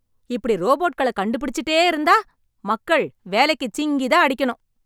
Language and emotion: Tamil, angry